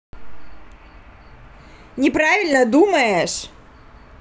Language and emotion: Russian, angry